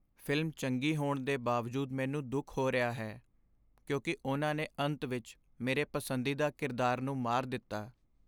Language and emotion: Punjabi, sad